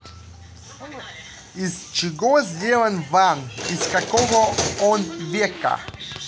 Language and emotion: Russian, neutral